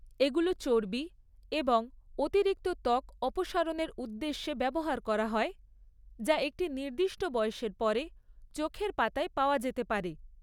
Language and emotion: Bengali, neutral